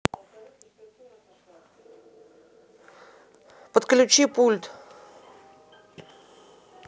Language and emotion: Russian, angry